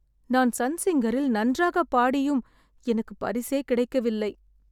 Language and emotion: Tamil, sad